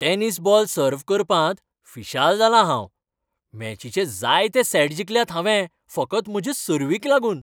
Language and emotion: Goan Konkani, happy